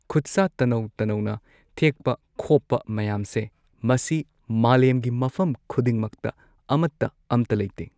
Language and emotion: Manipuri, neutral